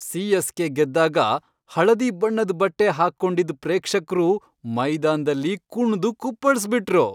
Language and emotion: Kannada, happy